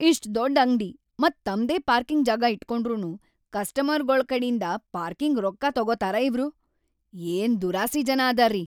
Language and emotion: Kannada, angry